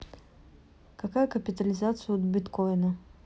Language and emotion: Russian, neutral